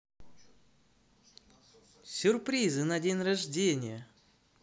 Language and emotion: Russian, positive